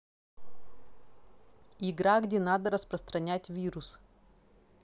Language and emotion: Russian, neutral